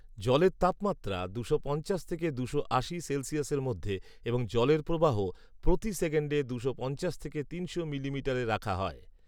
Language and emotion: Bengali, neutral